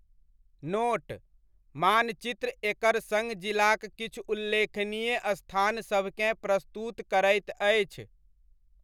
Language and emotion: Maithili, neutral